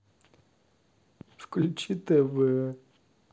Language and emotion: Russian, sad